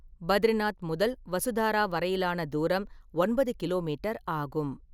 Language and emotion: Tamil, neutral